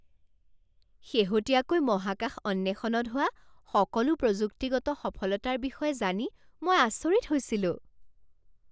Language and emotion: Assamese, surprised